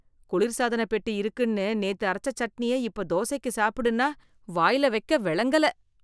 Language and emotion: Tamil, disgusted